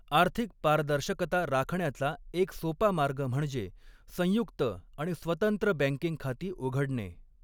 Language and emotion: Marathi, neutral